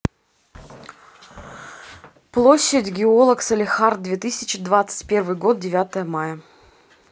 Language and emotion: Russian, neutral